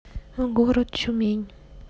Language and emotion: Russian, neutral